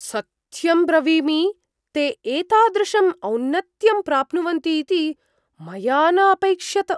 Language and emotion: Sanskrit, surprised